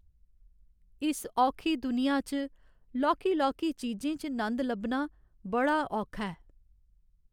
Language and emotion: Dogri, sad